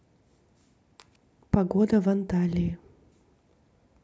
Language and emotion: Russian, neutral